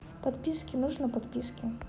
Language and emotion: Russian, neutral